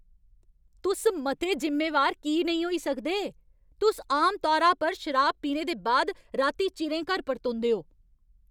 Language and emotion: Dogri, angry